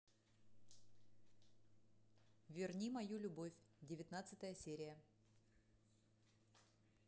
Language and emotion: Russian, neutral